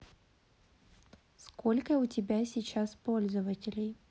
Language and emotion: Russian, neutral